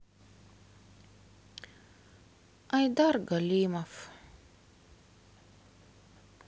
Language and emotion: Russian, sad